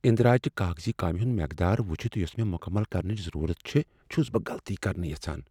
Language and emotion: Kashmiri, fearful